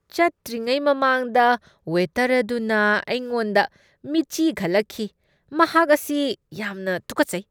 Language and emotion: Manipuri, disgusted